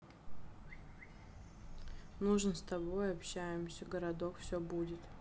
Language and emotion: Russian, sad